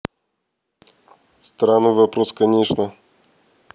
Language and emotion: Russian, neutral